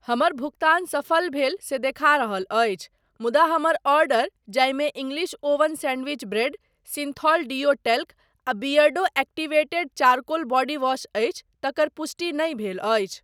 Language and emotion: Maithili, neutral